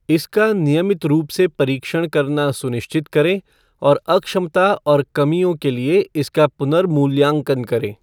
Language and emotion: Hindi, neutral